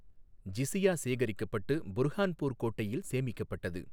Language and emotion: Tamil, neutral